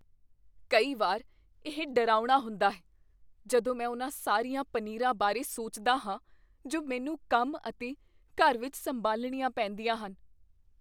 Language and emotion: Punjabi, fearful